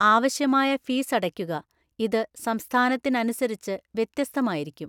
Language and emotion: Malayalam, neutral